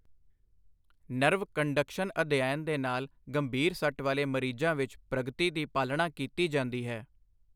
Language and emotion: Punjabi, neutral